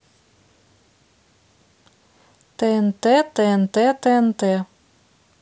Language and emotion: Russian, neutral